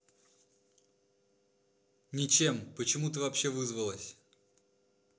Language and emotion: Russian, angry